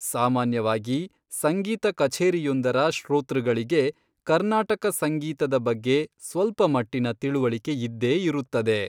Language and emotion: Kannada, neutral